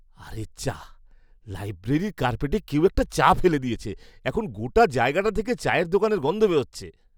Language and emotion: Bengali, disgusted